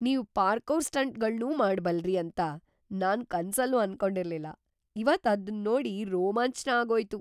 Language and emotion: Kannada, surprised